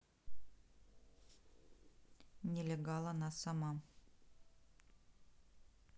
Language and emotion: Russian, neutral